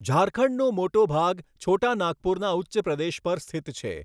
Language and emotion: Gujarati, neutral